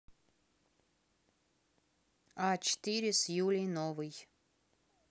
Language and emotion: Russian, neutral